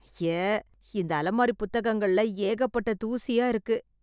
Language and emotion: Tamil, disgusted